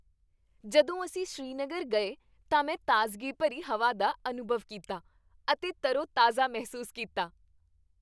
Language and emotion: Punjabi, happy